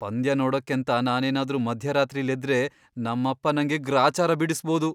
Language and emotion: Kannada, fearful